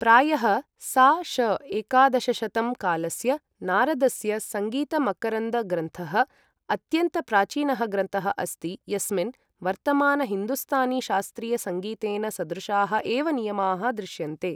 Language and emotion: Sanskrit, neutral